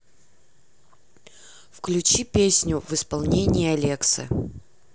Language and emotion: Russian, neutral